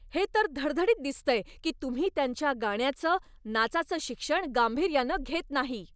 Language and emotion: Marathi, angry